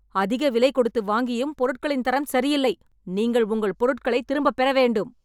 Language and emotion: Tamil, angry